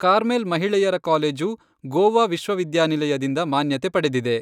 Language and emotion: Kannada, neutral